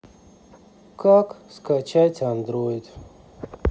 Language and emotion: Russian, sad